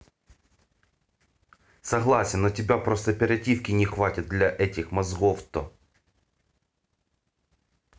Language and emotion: Russian, angry